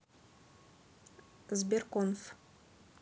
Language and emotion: Russian, neutral